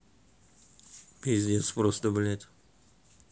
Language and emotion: Russian, neutral